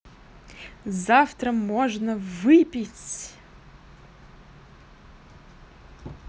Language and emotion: Russian, positive